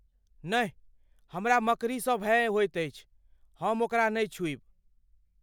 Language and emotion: Maithili, fearful